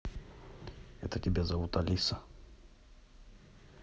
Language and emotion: Russian, neutral